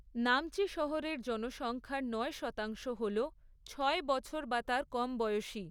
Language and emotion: Bengali, neutral